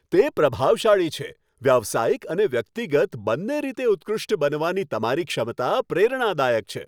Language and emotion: Gujarati, happy